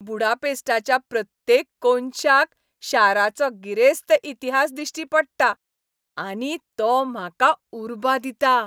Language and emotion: Goan Konkani, happy